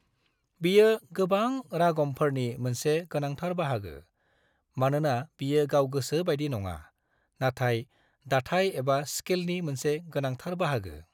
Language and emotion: Bodo, neutral